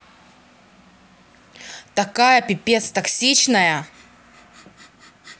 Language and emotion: Russian, angry